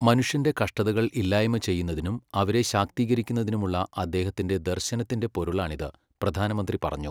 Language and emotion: Malayalam, neutral